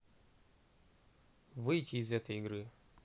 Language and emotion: Russian, neutral